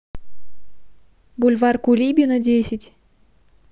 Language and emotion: Russian, neutral